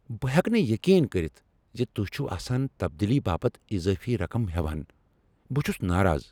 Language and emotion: Kashmiri, angry